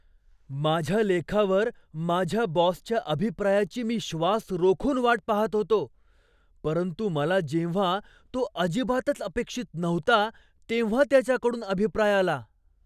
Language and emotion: Marathi, surprised